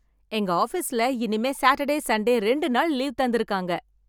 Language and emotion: Tamil, happy